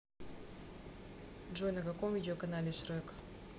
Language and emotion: Russian, neutral